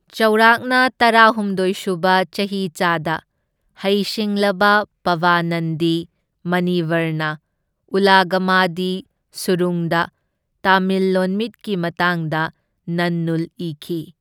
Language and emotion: Manipuri, neutral